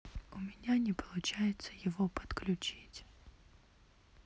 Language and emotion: Russian, sad